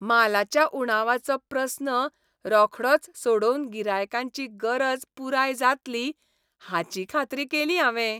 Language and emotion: Goan Konkani, happy